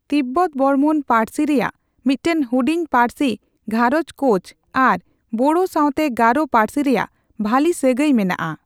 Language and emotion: Santali, neutral